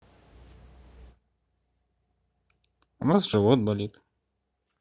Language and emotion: Russian, neutral